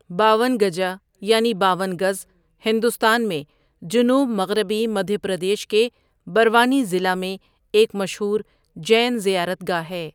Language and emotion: Urdu, neutral